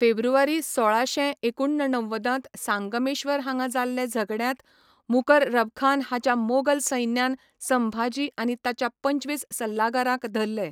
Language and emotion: Goan Konkani, neutral